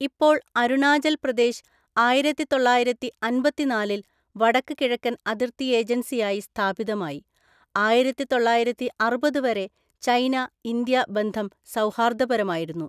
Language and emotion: Malayalam, neutral